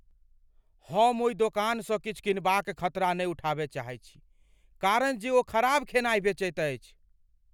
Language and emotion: Maithili, fearful